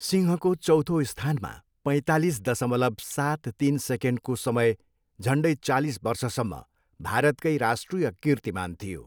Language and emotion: Nepali, neutral